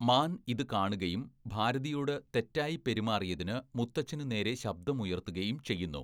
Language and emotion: Malayalam, neutral